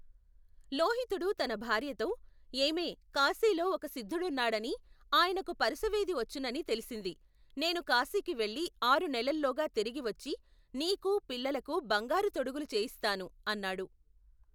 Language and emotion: Telugu, neutral